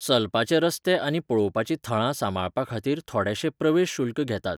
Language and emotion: Goan Konkani, neutral